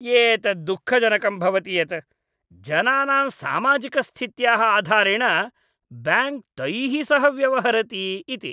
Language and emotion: Sanskrit, disgusted